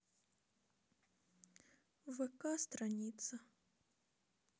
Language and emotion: Russian, sad